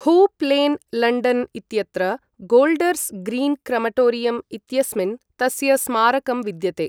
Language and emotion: Sanskrit, neutral